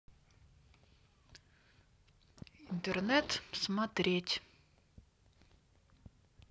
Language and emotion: Russian, neutral